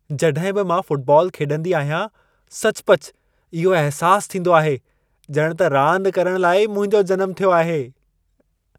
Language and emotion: Sindhi, happy